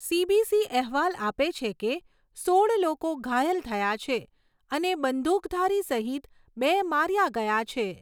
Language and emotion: Gujarati, neutral